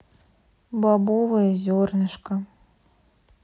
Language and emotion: Russian, sad